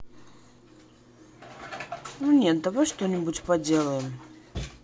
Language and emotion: Russian, neutral